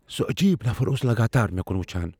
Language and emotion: Kashmiri, fearful